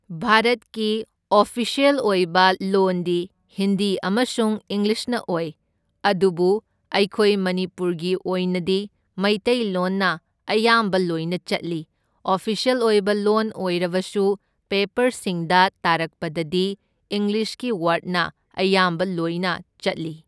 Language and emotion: Manipuri, neutral